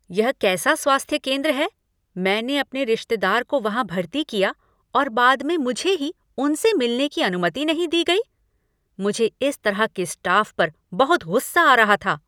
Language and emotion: Hindi, angry